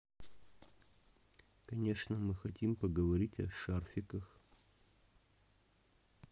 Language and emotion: Russian, neutral